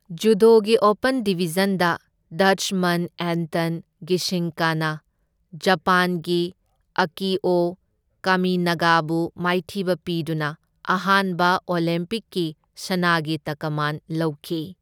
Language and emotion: Manipuri, neutral